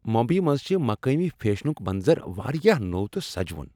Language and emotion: Kashmiri, happy